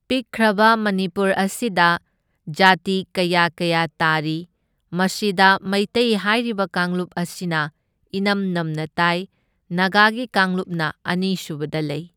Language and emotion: Manipuri, neutral